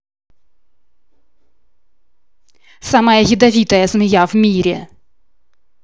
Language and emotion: Russian, angry